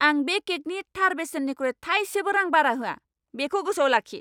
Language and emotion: Bodo, angry